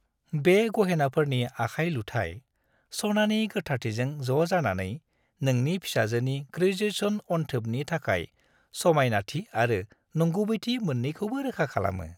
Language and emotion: Bodo, happy